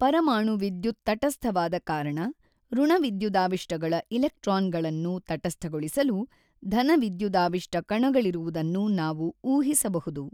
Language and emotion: Kannada, neutral